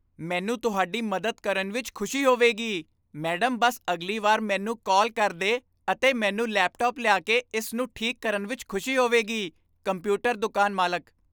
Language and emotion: Punjabi, happy